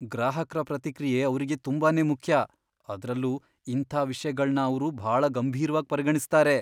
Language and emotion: Kannada, fearful